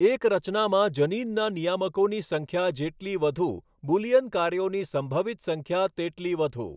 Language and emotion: Gujarati, neutral